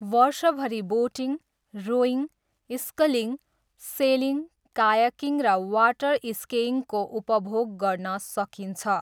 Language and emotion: Nepali, neutral